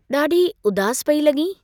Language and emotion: Sindhi, neutral